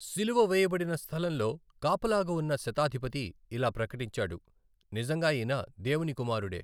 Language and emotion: Telugu, neutral